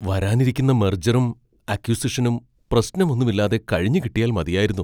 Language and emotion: Malayalam, fearful